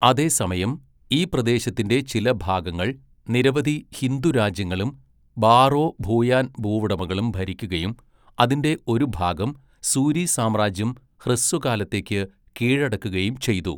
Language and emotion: Malayalam, neutral